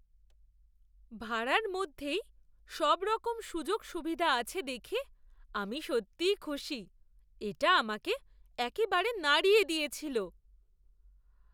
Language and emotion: Bengali, surprised